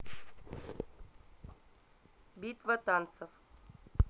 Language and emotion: Russian, neutral